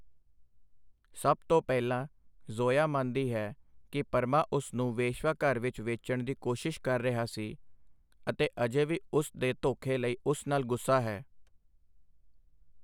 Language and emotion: Punjabi, neutral